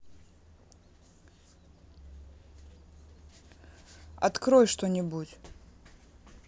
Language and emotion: Russian, neutral